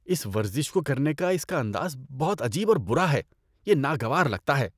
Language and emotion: Urdu, disgusted